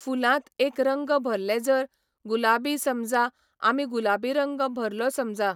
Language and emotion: Goan Konkani, neutral